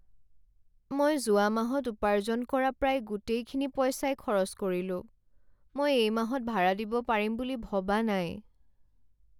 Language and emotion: Assamese, sad